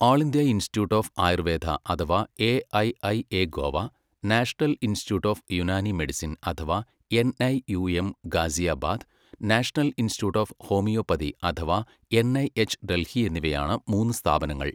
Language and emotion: Malayalam, neutral